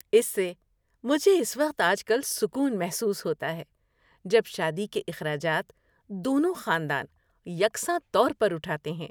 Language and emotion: Urdu, happy